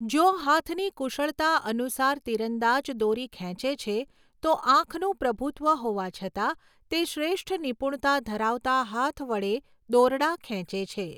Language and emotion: Gujarati, neutral